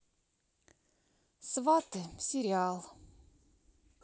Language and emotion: Russian, neutral